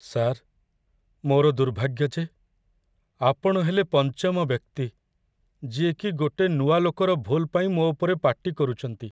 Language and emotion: Odia, sad